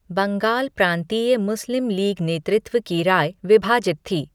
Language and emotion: Hindi, neutral